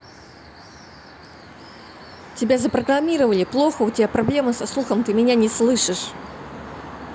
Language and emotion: Russian, angry